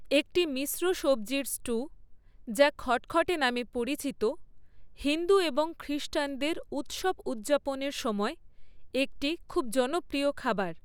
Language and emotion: Bengali, neutral